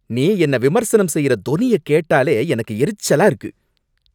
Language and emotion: Tamil, angry